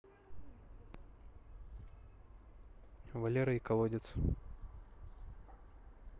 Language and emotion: Russian, neutral